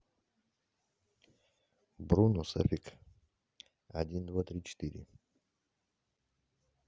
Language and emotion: Russian, neutral